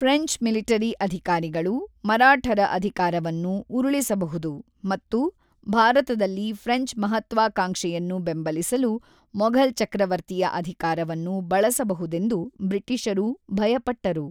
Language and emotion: Kannada, neutral